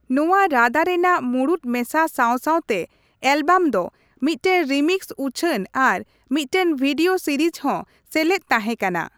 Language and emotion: Santali, neutral